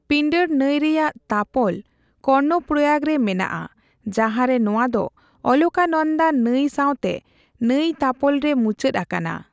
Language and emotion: Santali, neutral